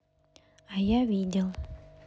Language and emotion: Russian, neutral